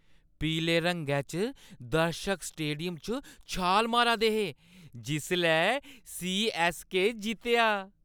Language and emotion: Dogri, happy